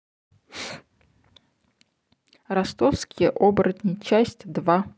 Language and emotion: Russian, neutral